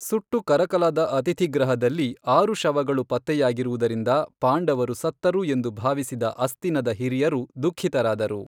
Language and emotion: Kannada, neutral